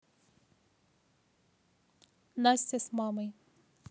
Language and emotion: Russian, neutral